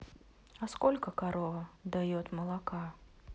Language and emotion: Russian, neutral